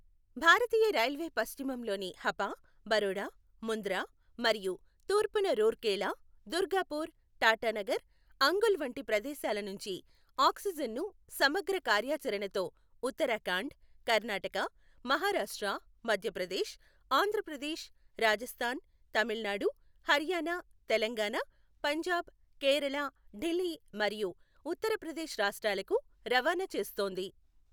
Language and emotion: Telugu, neutral